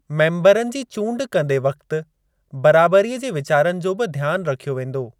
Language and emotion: Sindhi, neutral